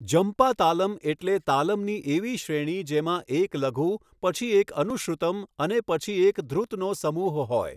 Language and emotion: Gujarati, neutral